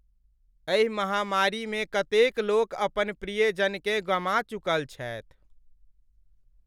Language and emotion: Maithili, sad